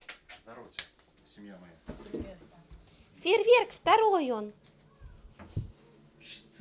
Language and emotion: Russian, positive